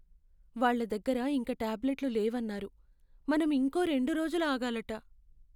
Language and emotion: Telugu, sad